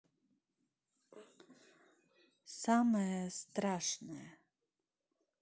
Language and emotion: Russian, neutral